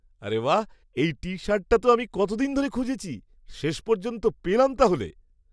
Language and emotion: Bengali, surprised